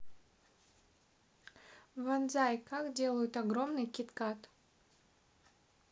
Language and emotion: Russian, neutral